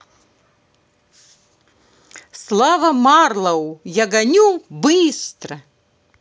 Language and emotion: Russian, positive